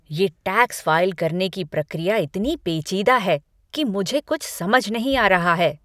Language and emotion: Hindi, angry